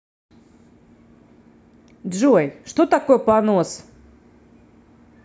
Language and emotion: Russian, neutral